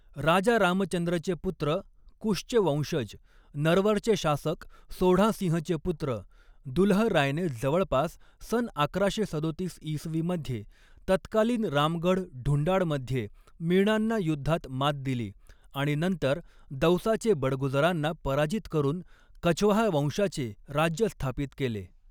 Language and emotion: Marathi, neutral